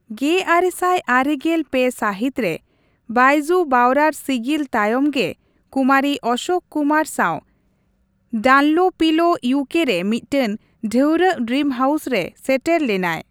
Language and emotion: Santali, neutral